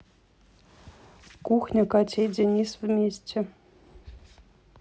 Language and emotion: Russian, neutral